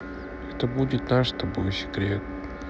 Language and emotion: Russian, sad